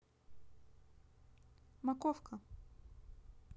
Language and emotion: Russian, neutral